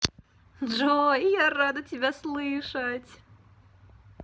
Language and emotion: Russian, positive